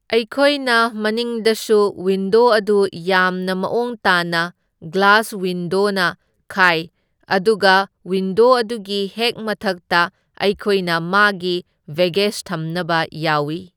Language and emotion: Manipuri, neutral